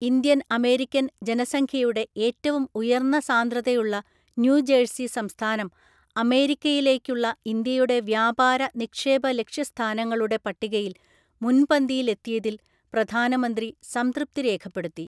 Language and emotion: Malayalam, neutral